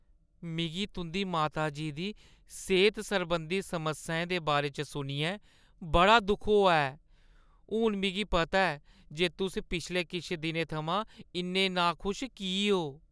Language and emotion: Dogri, sad